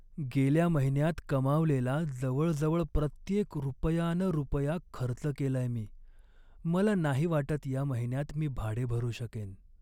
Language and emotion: Marathi, sad